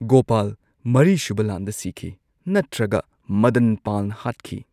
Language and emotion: Manipuri, neutral